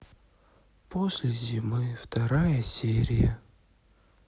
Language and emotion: Russian, sad